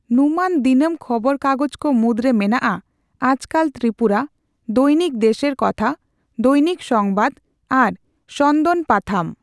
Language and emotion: Santali, neutral